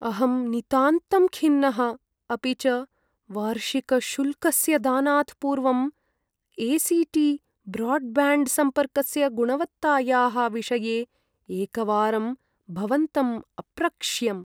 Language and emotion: Sanskrit, sad